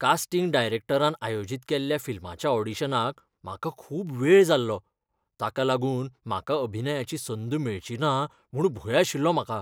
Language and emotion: Goan Konkani, fearful